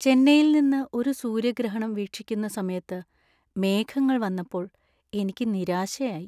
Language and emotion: Malayalam, sad